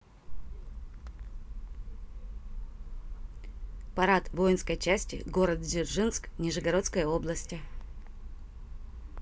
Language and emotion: Russian, neutral